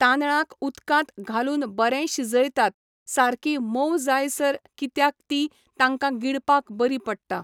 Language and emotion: Goan Konkani, neutral